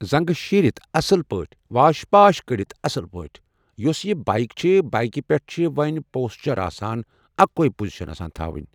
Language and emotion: Kashmiri, neutral